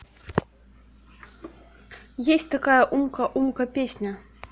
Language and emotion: Russian, neutral